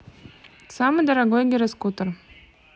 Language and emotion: Russian, neutral